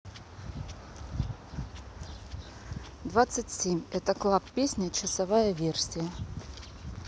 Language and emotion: Russian, neutral